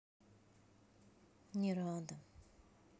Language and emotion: Russian, sad